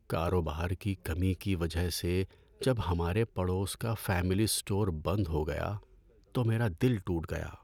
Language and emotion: Urdu, sad